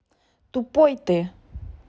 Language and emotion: Russian, angry